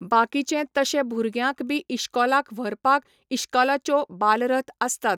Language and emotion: Goan Konkani, neutral